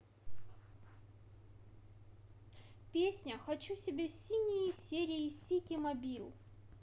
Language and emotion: Russian, positive